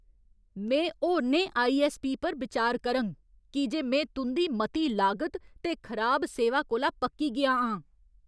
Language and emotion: Dogri, angry